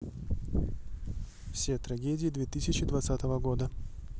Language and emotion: Russian, neutral